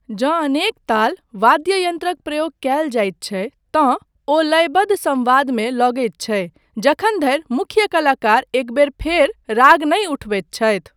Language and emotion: Maithili, neutral